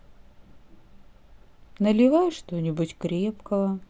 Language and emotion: Russian, sad